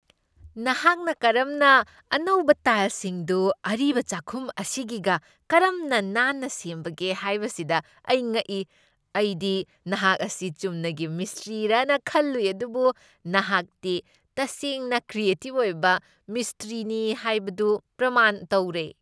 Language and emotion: Manipuri, surprised